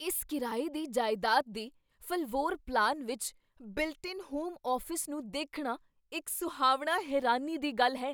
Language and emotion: Punjabi, surprised